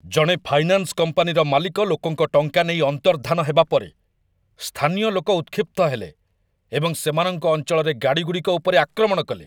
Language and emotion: Odia, angry